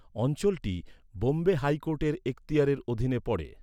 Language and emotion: Bengali, neutral